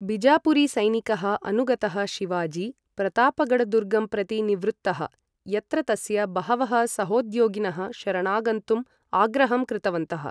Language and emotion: Sanskrit, neutral